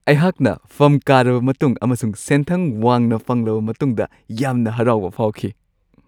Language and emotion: Manipuri, happy